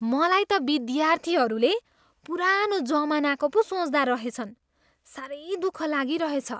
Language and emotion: Nepali, disgusted